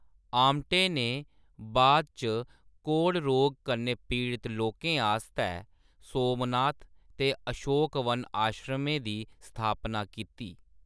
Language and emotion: Dogri, neutral